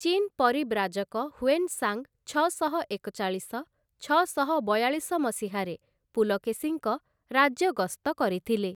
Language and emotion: Odia, neutral